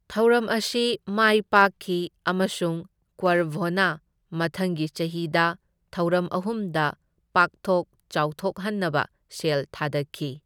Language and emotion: Manipuri, neutral